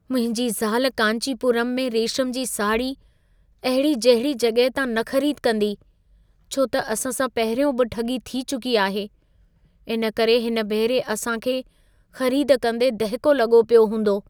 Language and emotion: Sindhi, fearful